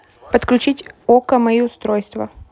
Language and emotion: Russian, neutral